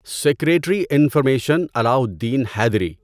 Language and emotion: Urdu, neutral